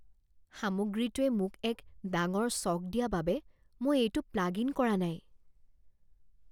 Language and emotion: Assamese, fearful